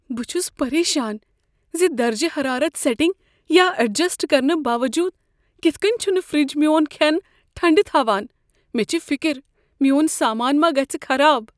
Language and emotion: Kashmiri, fearful